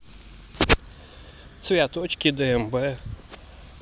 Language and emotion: Russian, neutral